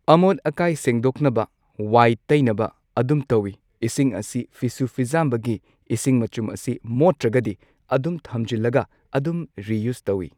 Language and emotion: Manipuri, neutral